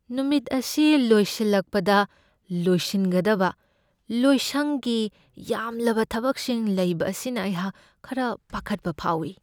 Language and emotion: Manipuri, fearful